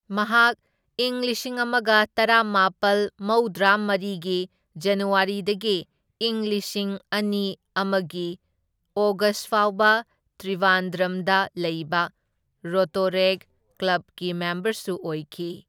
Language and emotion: Manipuri, neutral